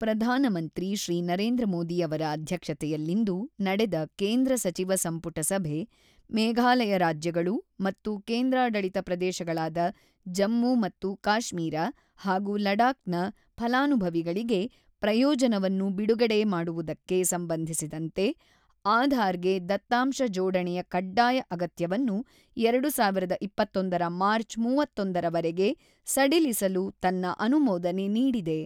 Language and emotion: Kannada, neutral